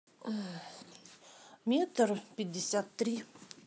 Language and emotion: Russian, neutral